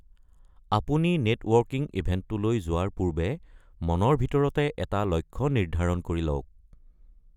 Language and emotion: Assamese, neutral